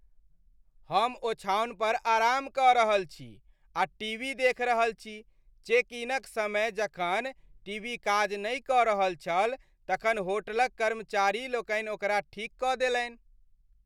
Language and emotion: Maithili, happy